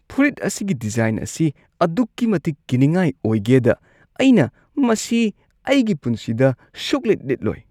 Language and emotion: Manipuri, disgusted